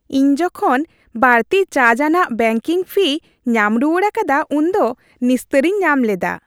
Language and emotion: Santali, happy